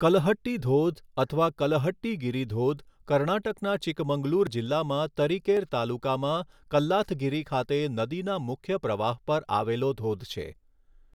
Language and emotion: Gujarati, neutral